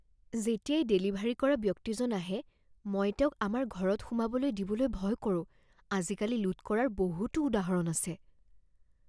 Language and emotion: Assamese, fearful